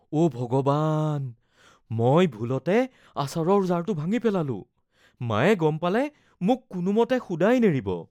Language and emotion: Assamese, fearful